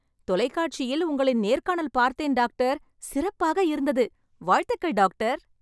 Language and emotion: Tamil, happy